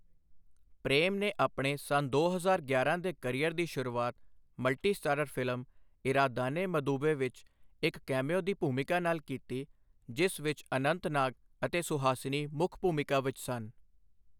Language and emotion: Punjabi, neutral